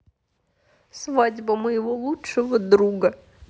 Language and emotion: Russian, sad